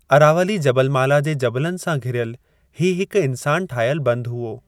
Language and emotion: Sindhi, neutral